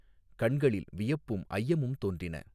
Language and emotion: Tamil, neutral